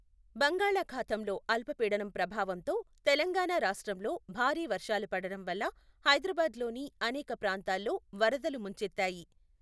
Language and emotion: Telugu, neutral